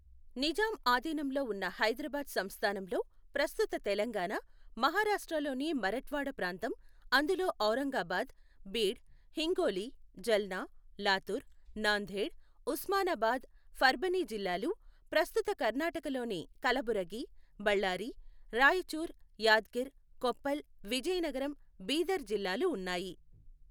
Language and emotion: Telugu, neutral